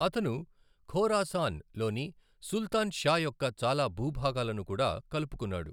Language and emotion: Telugu, neutral